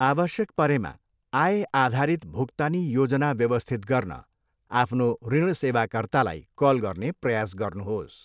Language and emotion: Nepali, neutral